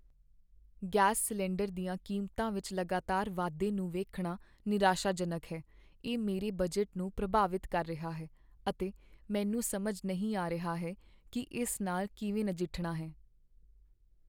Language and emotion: Punjabi, sad